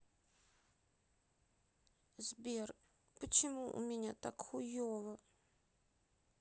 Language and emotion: Russian, sad